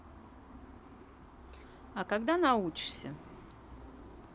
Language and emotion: Russian, neutral